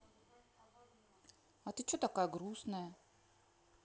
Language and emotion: Russian, neutral